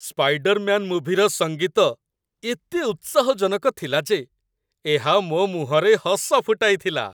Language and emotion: Odia, happy